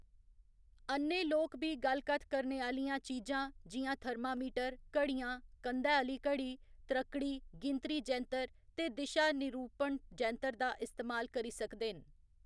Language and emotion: Dogri, neutral